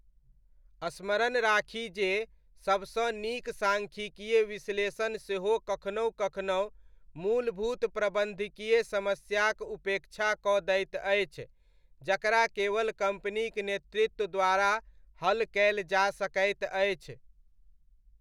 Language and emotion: Maithili, neutral